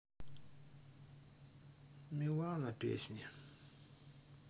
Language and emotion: Russian, sad